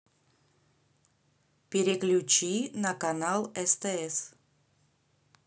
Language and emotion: Russian, neutral